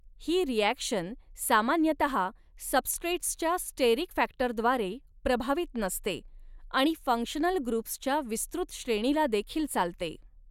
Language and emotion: Marathi, neutral